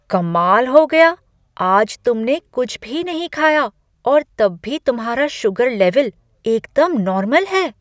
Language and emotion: Hindi, surprised